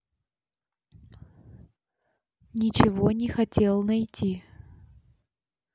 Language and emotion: Russian, neutral